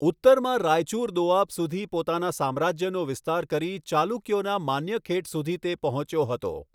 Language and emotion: Gujarati, neutral